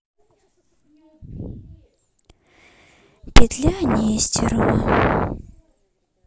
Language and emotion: Russian, sad